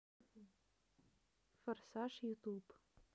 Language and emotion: Russian, neutral